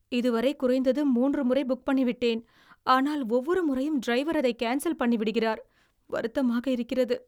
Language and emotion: Tamil, sad